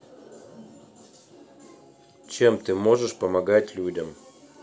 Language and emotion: Russian, neutral